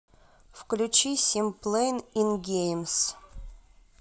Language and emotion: Russian, neutral